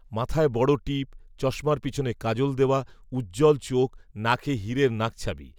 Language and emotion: Bengali, neutral